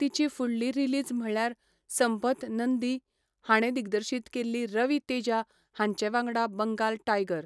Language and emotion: Goan Konkani, neutral